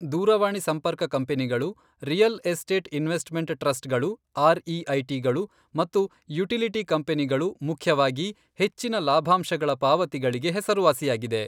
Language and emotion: Kannada, neutral